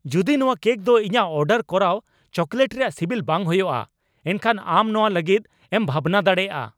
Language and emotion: Santali, angry